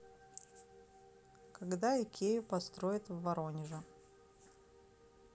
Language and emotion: Russian, neutral